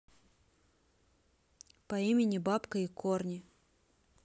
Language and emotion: Russian, neutral